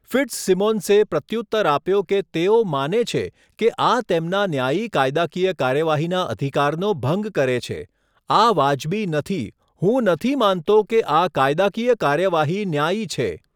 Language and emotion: Gujarati, neutral